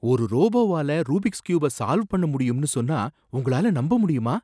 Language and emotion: Tamil, surprised